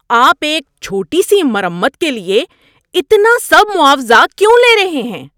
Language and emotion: Urdu, angry